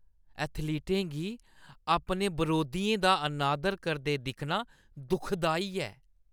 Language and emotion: Dogri, disgusted